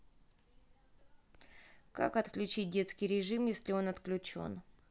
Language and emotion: Russian, neutral